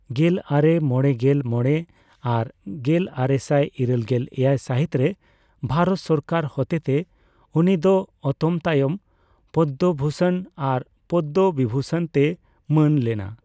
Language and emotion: Santali, neutral